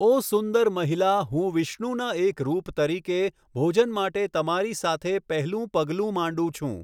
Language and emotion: Gujarati, neutral